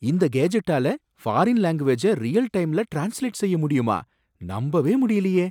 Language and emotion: Tamil, surprised